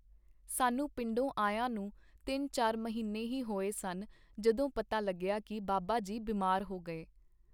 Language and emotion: Punjabi, neutral